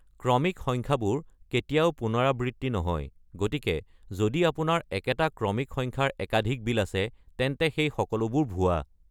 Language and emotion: Assamese, neutral